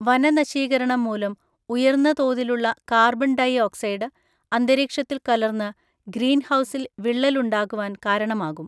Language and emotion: Malayalam, neutral